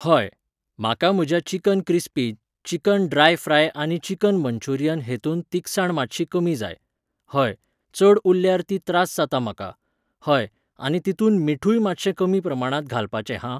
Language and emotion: Goan Konkani, neutral